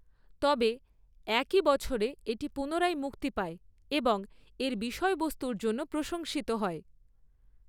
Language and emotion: Bengali, neutral